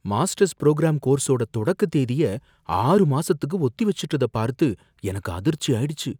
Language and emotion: Tamil, fearful